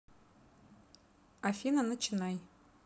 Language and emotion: Russian, neutral